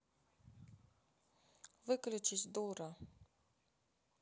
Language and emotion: Russian, neutral